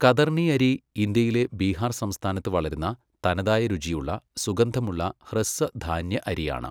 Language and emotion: Malayalam, neutral